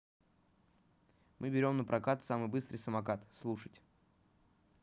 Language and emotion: Russian, neutral